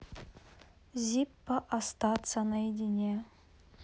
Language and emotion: Russian, neutral